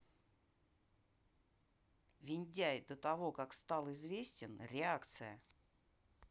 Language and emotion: Russian, neutral